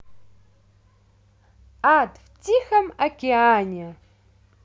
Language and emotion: Russian, positive